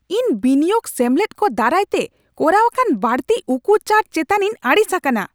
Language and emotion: Santali, angry